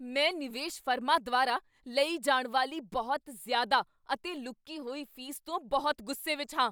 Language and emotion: Punjabi, angry